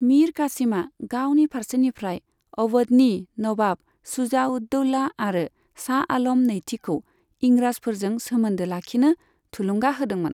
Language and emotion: Bodo, neutral